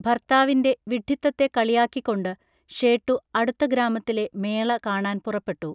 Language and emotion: Malayalam, neutral